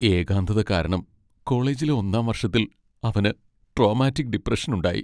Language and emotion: Malayalam, sad